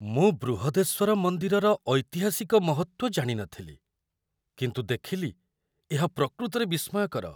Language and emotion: Odia, surprised